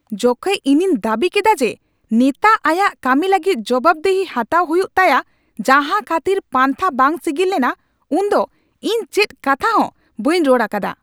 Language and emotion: Santali, angry